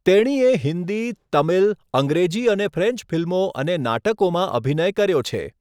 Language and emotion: Gujarati, neutral